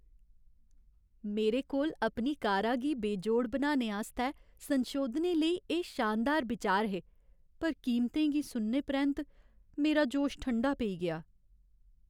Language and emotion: Dogri, sad